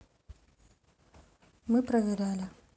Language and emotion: Russian, neutral